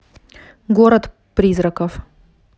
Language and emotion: Russian, neutral